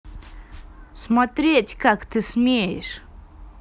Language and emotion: Russian, angry